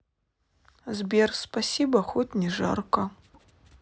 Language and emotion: Russian, sad